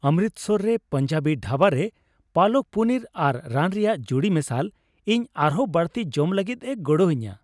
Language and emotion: Santali, happy